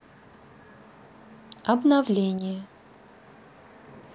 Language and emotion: Russian, neutral